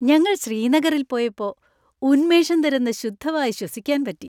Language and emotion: Malayalam, happy